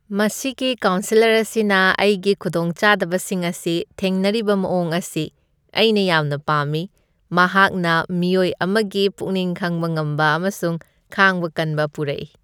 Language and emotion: Manipuri, happy